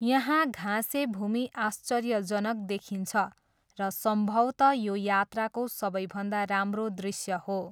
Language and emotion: Nepali, neutral